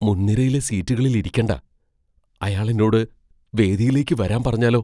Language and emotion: Malayalam, fearful